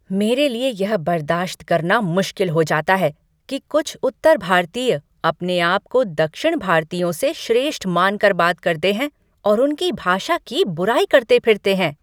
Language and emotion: Hindi, angry